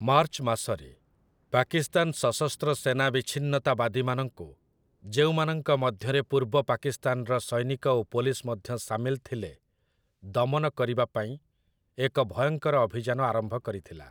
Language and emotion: Odia, neutral